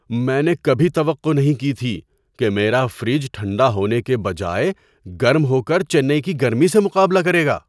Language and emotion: Urdu, surprised